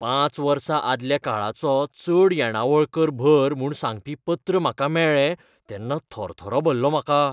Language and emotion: Goan Konkani, fearful